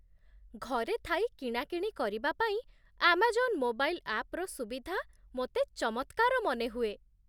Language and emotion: Odia, surprised